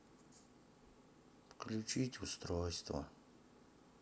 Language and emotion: Russian, sad